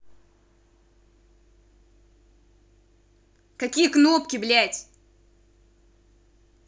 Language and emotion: Russian, angry